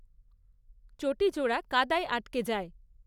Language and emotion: Bengali, neutral